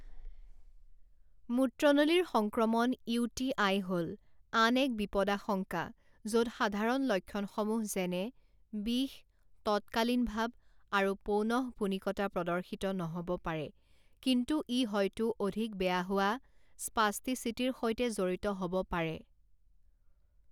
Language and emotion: Assamese, neutral